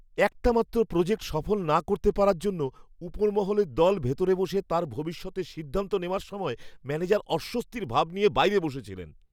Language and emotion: Bengali, fearful